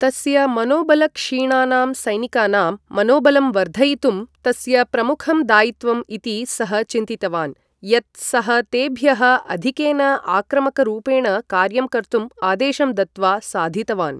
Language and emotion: Sanskrit, neutral